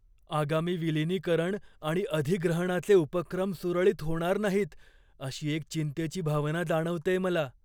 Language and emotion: Marathi, fearful